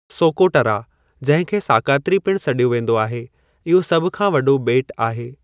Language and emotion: Sindhi, neutral